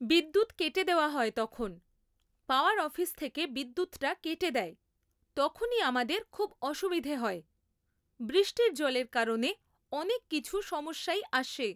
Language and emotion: Bengali, neutral